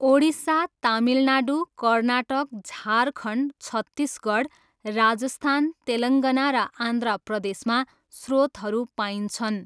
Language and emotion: Nepali, neutral